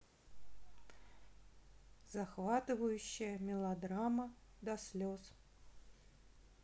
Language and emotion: Russian, neutral